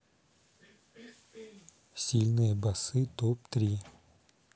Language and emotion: Russian, neutral